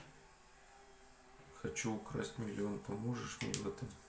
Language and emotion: Russian, sad